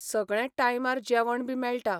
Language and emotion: Goan Konkani, neutral